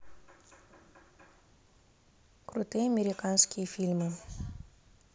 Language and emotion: Russian, neutral